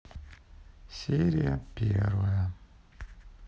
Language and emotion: Russian, sad